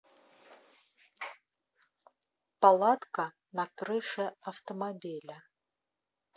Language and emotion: Russian, neutral